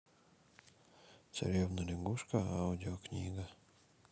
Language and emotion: Russian, neutral